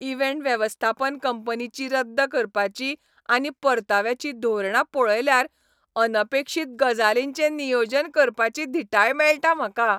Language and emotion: Goan Konkani, happy